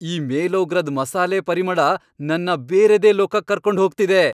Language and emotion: Kannada, happy